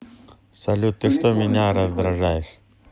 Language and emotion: Russian, neutral